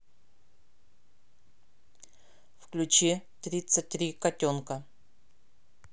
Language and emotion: Russian, neutral